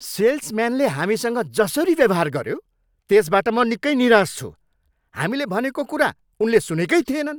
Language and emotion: Nepali, angry